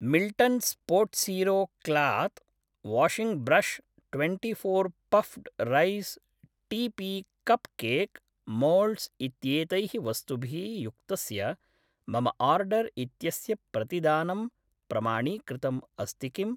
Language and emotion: Sanskrit, neutral